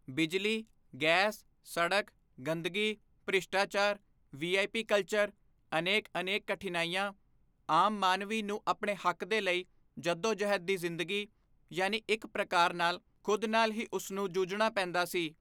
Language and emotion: Punjabi, neutral